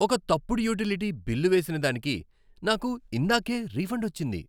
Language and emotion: Telugu, happy